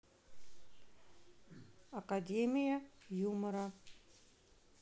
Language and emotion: Russian, neutral